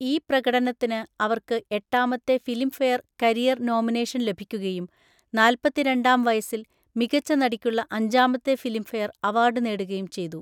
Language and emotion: Malayalam, neutral